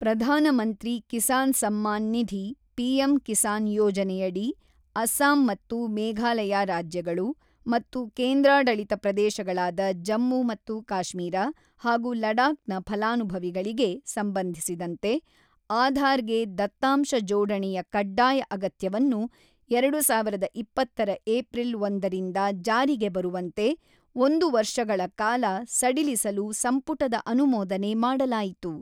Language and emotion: Kannada, neutral